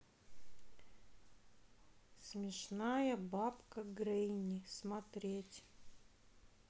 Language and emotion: Russian, neutral